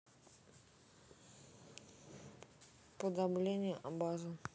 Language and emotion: Russian, neutral